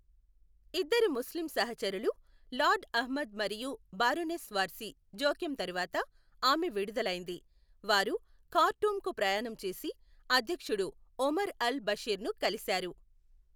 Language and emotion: Telugu, neutral